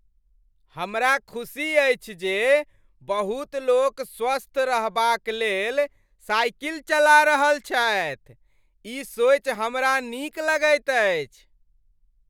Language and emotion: Maithili, happy